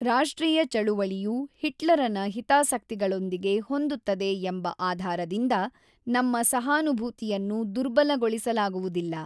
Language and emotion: Kannada, neutral